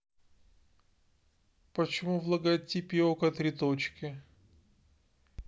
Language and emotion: Russian, neutral